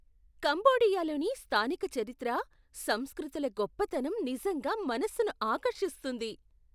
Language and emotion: Telugu, surprised